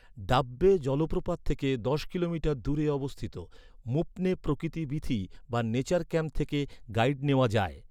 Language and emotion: Bengali, neutral